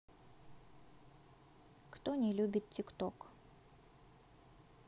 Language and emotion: Russian, neutral